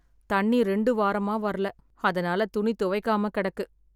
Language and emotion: Tamil, sad